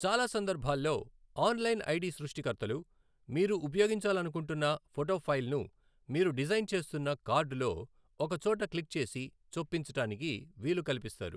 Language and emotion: Telugu, neutral